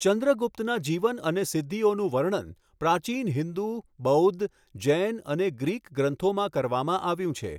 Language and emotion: Gujarati, neutral